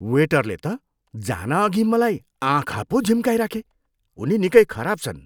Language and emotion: Nepali, disgusted